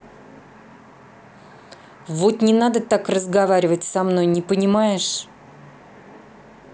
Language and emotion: Russian, angry